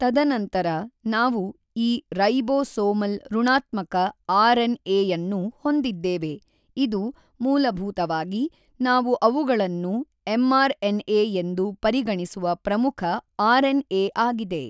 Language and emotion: Kannada, neutral